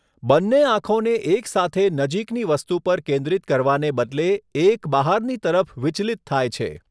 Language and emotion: Gujarati, neutral